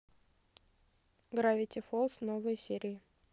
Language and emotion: Russian, neutral